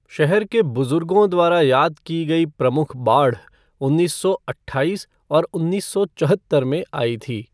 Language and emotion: Hindi, neutral